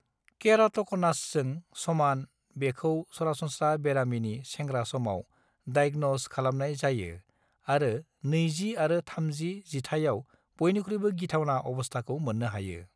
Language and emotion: Bodo, neutral